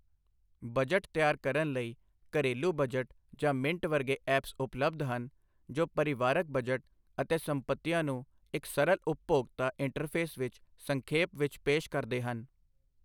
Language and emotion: Punjabi, neutral